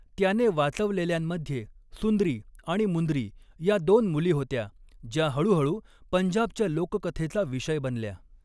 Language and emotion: Marathi, neutral